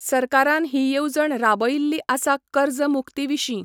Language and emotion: Goan Konkani, neutral